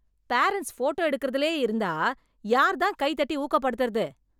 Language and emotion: Tamil, angry